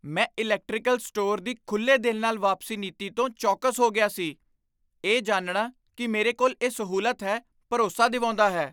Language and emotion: Punjabi, surprised